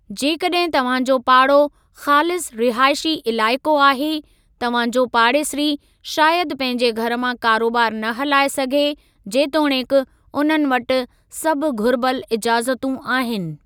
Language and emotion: Sindhi, neutral